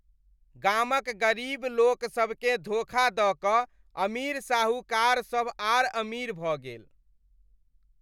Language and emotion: Maithili, disgusted